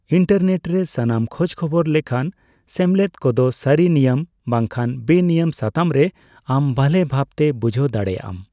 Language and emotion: Santali, neutral